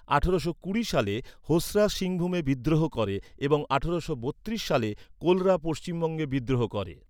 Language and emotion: Bengali, neutral